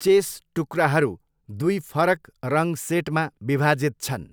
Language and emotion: Nepali, neutral